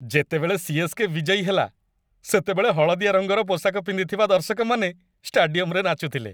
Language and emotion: Odia, happy